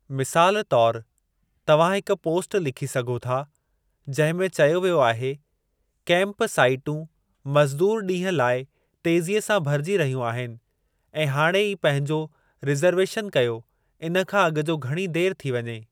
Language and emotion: Sindhi, neutral